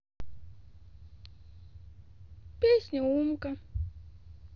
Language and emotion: Russian, neutral